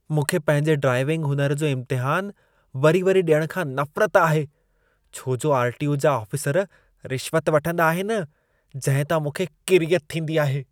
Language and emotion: Sindhi, disgusted